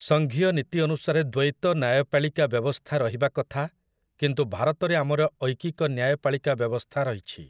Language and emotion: Odia, neutral